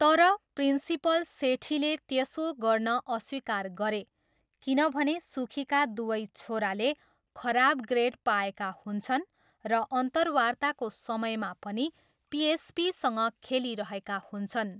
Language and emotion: Nepali, neutral